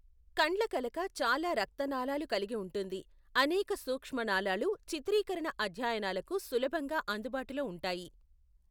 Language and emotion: Telugu, neutral